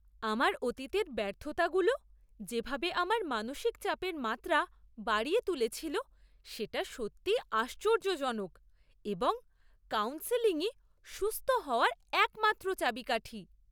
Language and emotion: Bengali, surprised